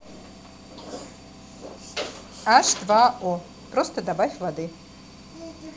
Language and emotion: Russian, neutral